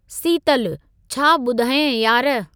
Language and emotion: Sindhi, neutral